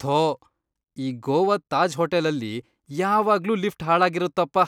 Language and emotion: Kannada, disgusted